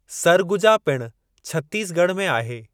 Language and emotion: Sindhi, neutral